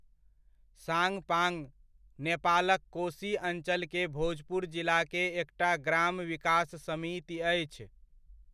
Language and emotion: Maithili, neutral